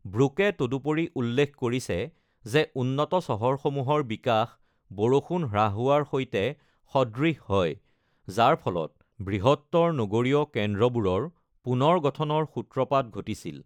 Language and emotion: Assamese, neutral